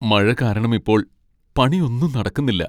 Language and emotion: Malayalam, sad